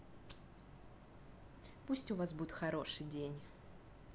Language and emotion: Russian, positive